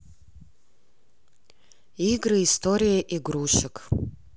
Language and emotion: Russian, neutral